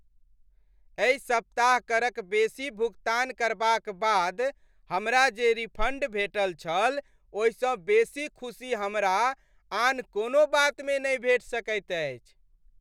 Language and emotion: Maithili, happy